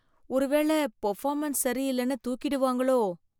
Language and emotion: Tamil, fearful